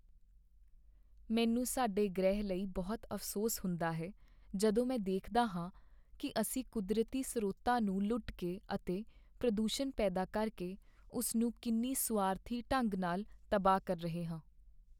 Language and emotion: Punjabi, sad